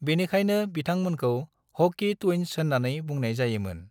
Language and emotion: Bodo, neutral